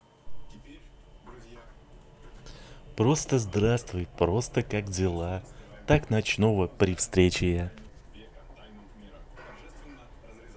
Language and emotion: Russian, positive